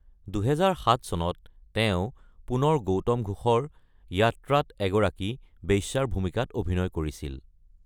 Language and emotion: Assamese, neutral